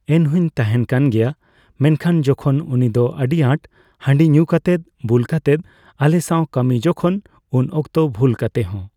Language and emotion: Santali, neutral